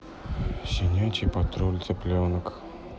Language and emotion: Russian, sad